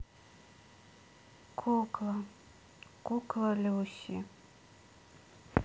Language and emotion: Russian, sad